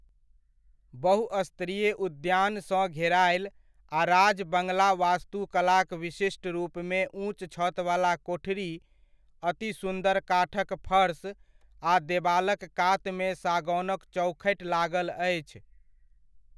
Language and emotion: Maithili, neutral